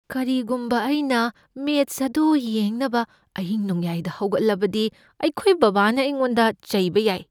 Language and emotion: Manipuri, fearful